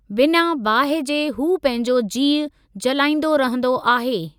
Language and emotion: Sindhi, neutral